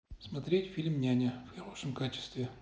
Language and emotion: Russian, neutral